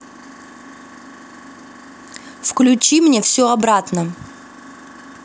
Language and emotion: Russian, angry